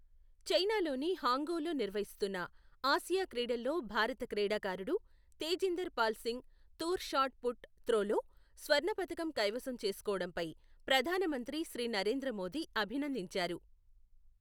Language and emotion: Telugu, neutral